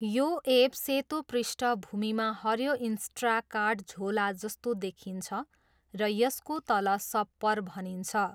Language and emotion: Nepali, neutral